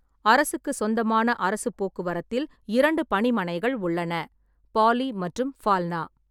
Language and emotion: Tamil, neutral